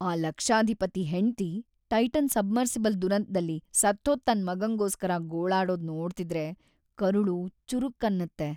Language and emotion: Kannada, sad